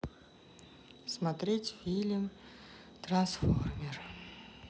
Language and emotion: Russian, sad